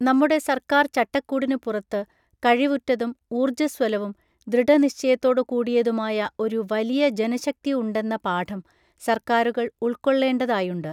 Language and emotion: Malayalam, neutral